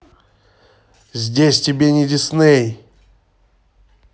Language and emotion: Russian, angry